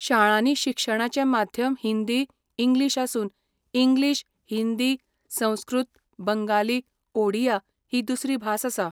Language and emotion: Goan Konkani, neutral